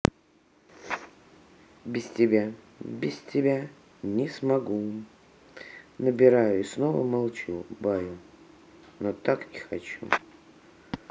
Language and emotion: Russian, neutral